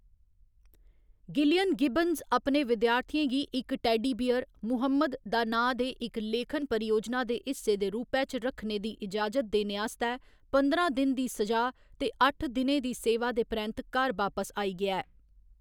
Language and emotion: Dogri, neutral